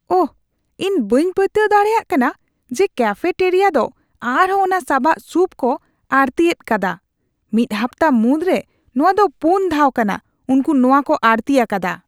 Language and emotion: Santali, disgusted